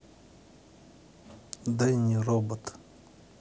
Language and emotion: Russian, neutral